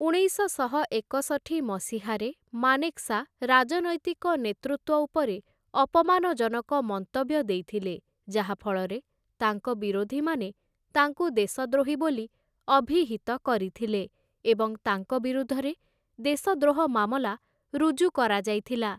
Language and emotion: Odia, neutral